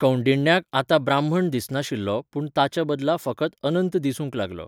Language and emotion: Goan Konkani, neutral